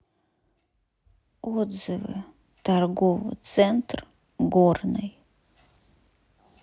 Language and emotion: Russian, sad